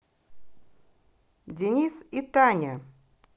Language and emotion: Russian, neutral